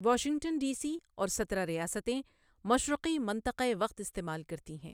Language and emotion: Urdu, neutral